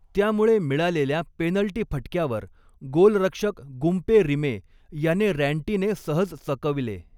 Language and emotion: Marathi, neutral